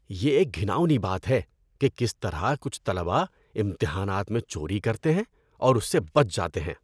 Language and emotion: Urdu, disgusted